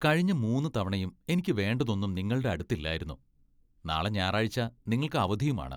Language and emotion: Malayalam, disgusted